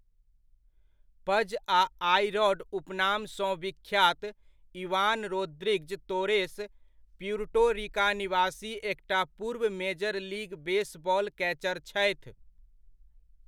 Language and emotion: Maithili, neutral